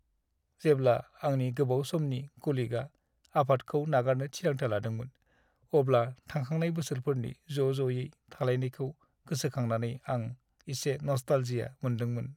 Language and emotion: Bodo, sad